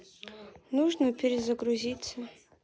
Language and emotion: Russian, neutral